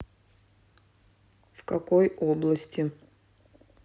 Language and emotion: Russian, neutral